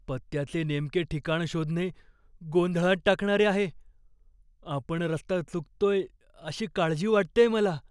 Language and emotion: Marathi, fearful